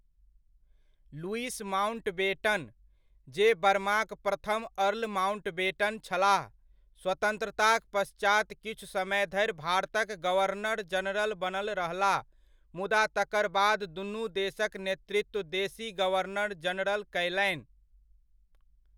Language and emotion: Maithili, neutral